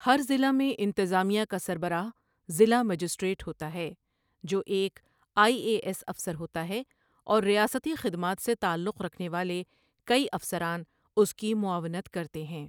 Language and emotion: Urdu, neutral